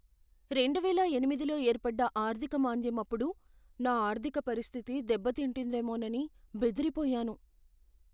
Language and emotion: Telugu, fearful